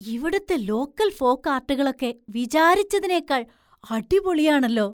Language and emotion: Malayalam, surprised